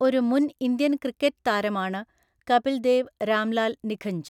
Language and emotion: Malayalam, neutral